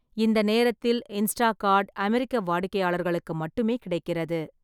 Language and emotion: Tamil, neutral